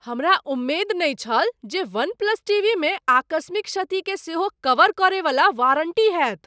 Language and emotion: Maithili, surprised